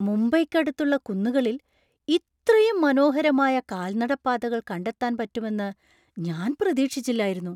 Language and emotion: Malayalam, surprised